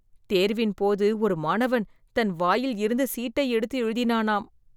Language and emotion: Tamil, disgusted